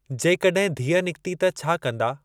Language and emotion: Sindhi, neutral